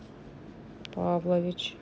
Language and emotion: Russian, neutral